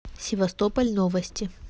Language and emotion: Russian, neutral